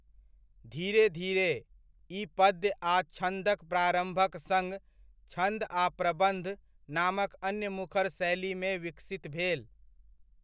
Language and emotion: Maithili, neutral